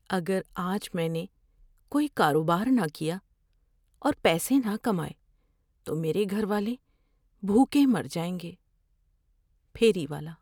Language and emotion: Urdu, fearful